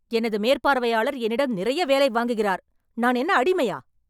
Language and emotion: Tamil, angry